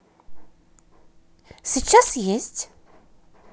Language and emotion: Russian, positive